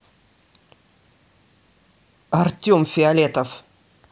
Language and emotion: Russian, angry